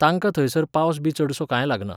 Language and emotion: Goan Konkani, neutral